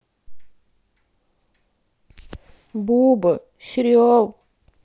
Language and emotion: Russian, sad